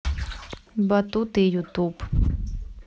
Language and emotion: Russian, neutral